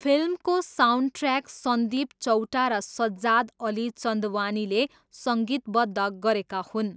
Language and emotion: Nepali, neutral